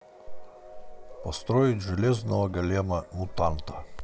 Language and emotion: Russian, neutral